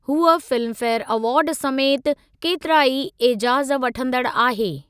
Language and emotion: Sindhi, neutral